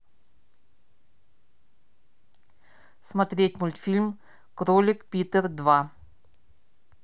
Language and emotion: Russian, neutral